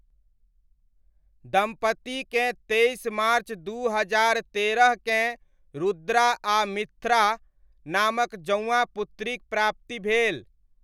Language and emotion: Maithili, neutral